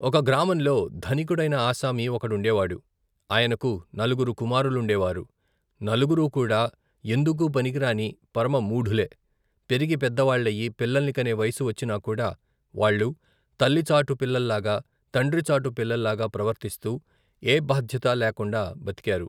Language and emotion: Telugu, neutral